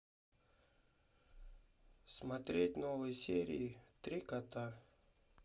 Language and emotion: Russian, neutral